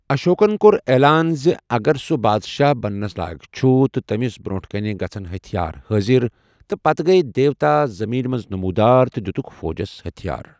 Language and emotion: Kashmiri, neutral